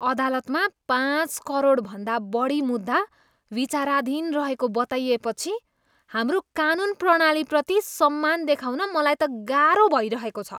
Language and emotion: Nepali, disgusted